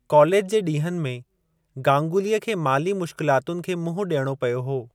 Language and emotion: Sindhi, neutral